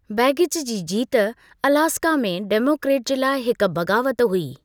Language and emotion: Sindhi, neutral